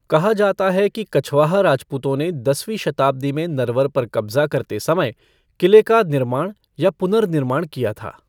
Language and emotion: Hindi, neutral